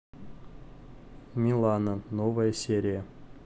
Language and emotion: Russian, neutral